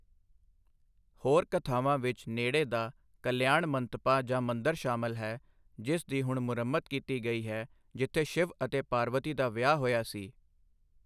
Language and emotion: Punjabi, neutral